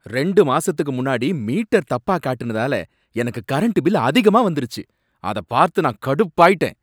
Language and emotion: Tamil, angry